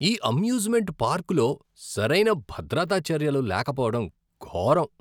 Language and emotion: Telugu, disgusted